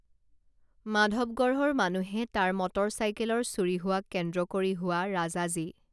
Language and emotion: Assamese, neutral